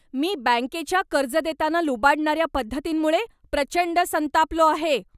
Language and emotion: Marathi, angry